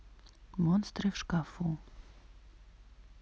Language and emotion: Russian, sad